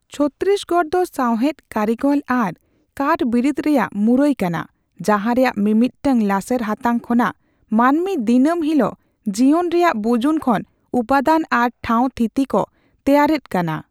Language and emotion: Santali, neutral